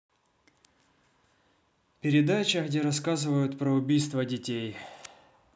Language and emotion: Russian, neutral